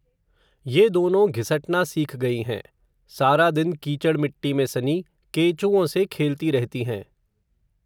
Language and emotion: Hindi, neutral